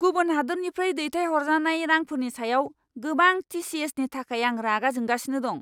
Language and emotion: Bodo, angry